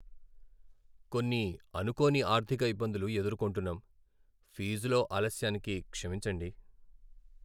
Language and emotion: Telugu, sad